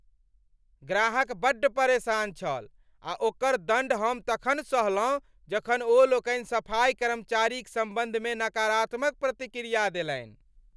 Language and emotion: Maithili, angry